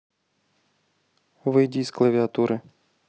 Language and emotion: Russian, neutral